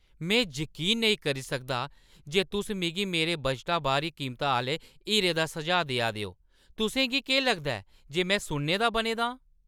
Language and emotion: Dogri, angry